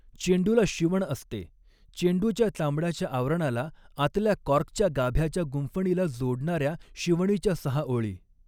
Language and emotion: Marathi, neutral